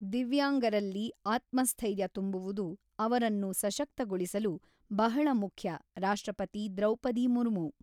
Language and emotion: Kannada, neutral